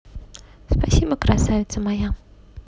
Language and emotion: Russian, positive